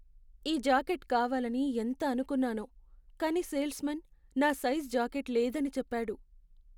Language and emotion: Telugu, sad